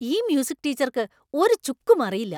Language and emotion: Malayalam, angry